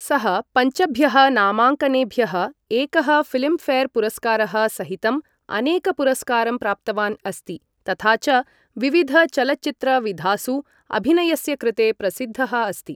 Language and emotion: Sanskrit, neutral